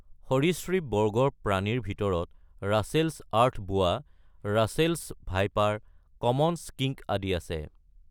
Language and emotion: Assamese, neutral